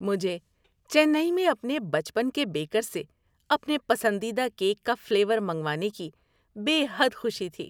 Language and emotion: Urdu, happy